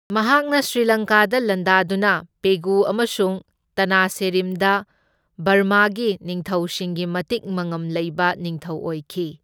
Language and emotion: Manipuri, neutral